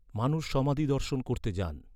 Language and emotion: Bengali, neutral